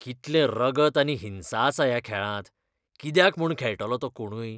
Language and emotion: Goan Konkani, disgusted